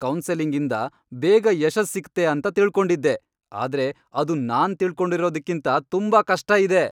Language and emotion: Kannada, angry